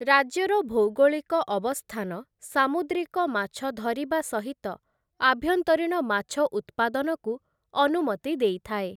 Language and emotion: Odia, neutral